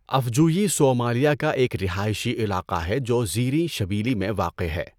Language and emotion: Urdu, neutral